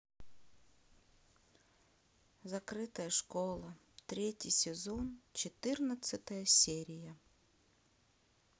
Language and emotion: Russian, sad